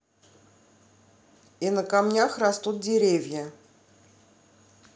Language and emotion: Russian, neutral